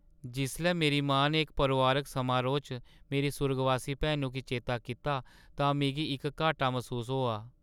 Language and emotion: Dogri, sad